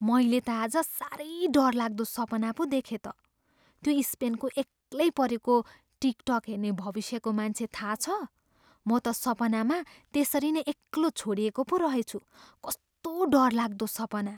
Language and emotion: Nepali, fearful